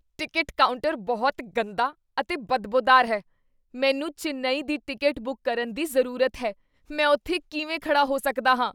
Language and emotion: Punjabi, disgusted